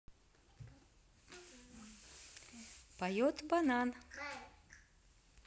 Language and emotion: Russian, positive